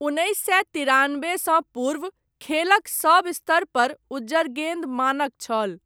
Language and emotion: Maithili, neutral